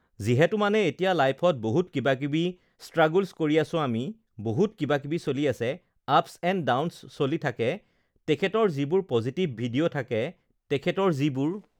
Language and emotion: Assamese, neutral